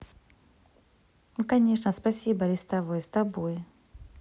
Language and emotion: Russian, positive